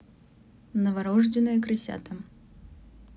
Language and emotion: Russian, neutral